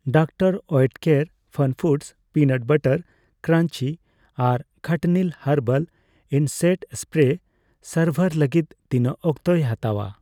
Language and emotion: Santali, neutral